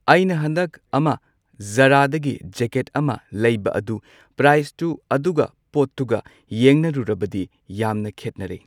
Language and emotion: Manipuri, neutral